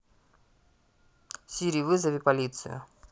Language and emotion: Russian, neutral